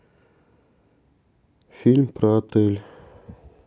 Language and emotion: Russian, neutral